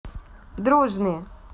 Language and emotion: Russian, positive